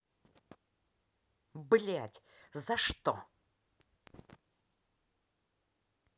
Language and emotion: Russian, angry